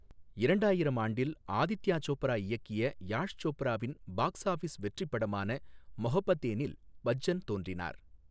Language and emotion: Tamil, neutral